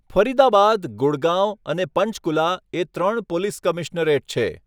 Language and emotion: Gujarati, neutral